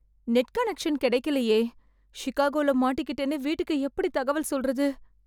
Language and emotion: Tamil, fearful